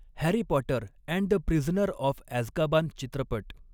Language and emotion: Marathi, neutral